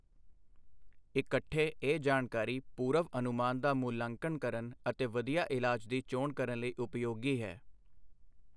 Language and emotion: Punjabi, neutral